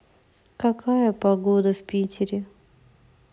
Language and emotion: Russian, sad